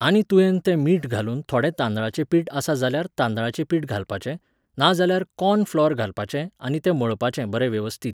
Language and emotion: Goan Konkani, neutral